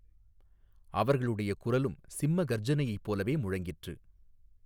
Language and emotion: Tamil, neutral